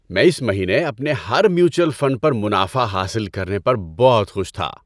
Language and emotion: Urdu, happy